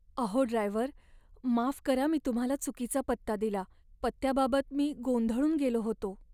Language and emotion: Marathi, sad